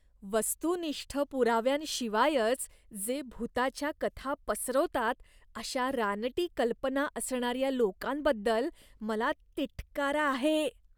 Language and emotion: Marathi, disgusted